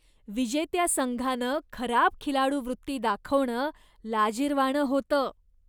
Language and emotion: Marathi, disgusted